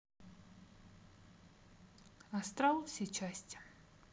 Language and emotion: Russian, neutral